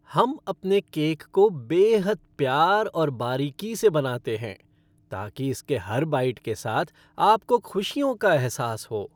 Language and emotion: Hindi, happy